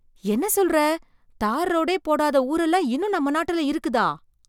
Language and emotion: Tamil, surprised